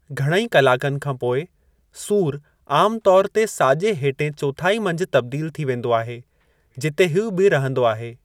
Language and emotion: Sindhi, neutral